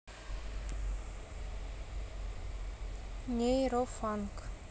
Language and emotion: Russian, neutral